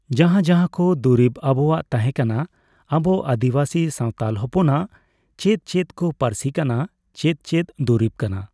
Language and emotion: Santali, neutral